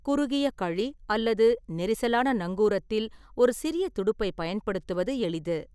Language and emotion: Tamil, neutral